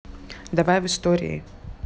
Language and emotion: Russian, neutral